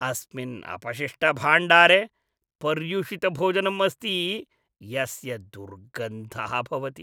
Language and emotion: Sanskrit, disgusted